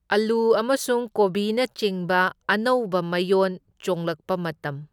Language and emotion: Manipuri, neutral